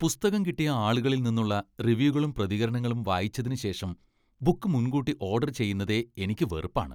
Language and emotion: Malayalam, disgusted